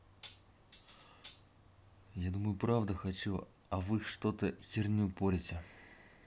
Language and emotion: Russian, neutral